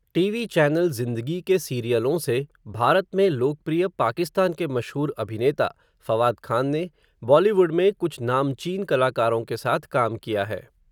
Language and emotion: Hindi, neutral